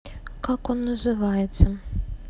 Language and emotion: Russian, sad